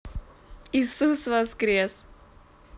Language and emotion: Russian, positive